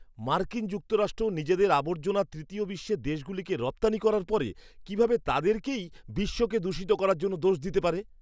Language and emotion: Bengali, disgusted